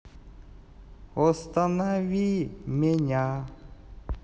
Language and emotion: Russian, neutral